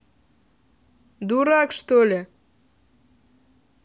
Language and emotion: Russian, angry